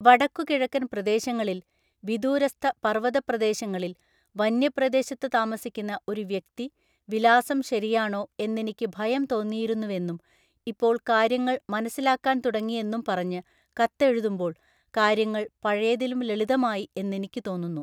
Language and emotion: Malayalam, neutral